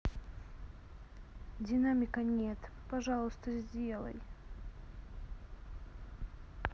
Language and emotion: Russian, sad